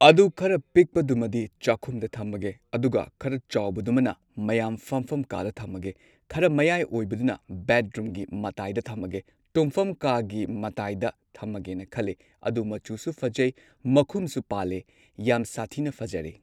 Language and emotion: Manipuri, neutral